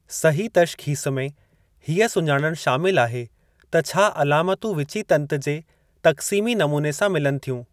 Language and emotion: Sindhi, neutral